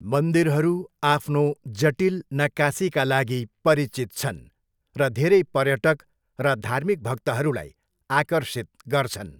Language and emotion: Nepali, neutral